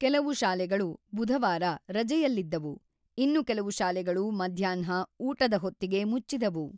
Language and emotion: Kannada, neutral